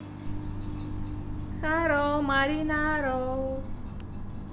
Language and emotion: Russian, positive